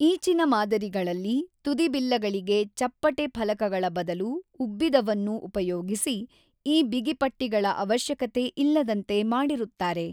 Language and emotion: Kannada, neutral